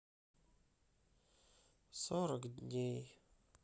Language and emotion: Russian, sad